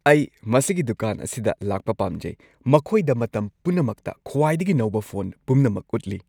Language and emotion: Manipuri, happy